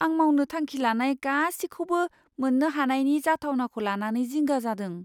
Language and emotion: Bodo, fearful